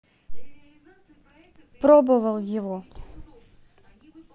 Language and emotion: Russian, neutral